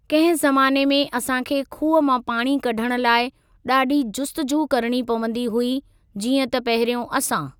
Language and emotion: Sindhi, neutral